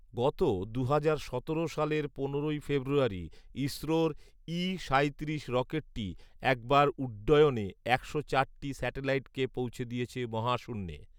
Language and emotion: Bengali, neutral